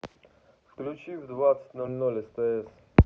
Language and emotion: Russian, neutral